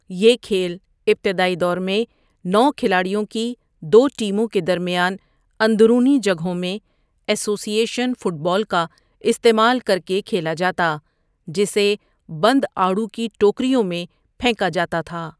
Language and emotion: Urdu, neutral